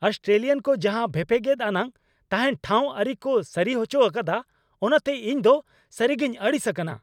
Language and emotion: Santali, angry